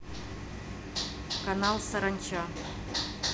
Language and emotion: Russian, neutral